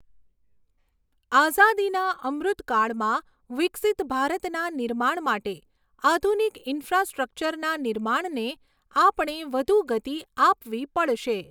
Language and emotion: Gujarati, neutral